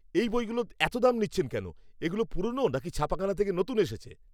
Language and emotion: Bengali, angry